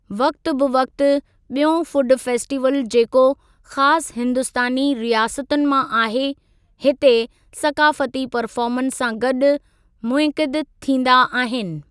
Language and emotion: Sindhi, neutral